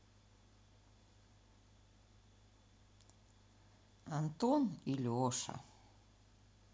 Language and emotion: Russian, sad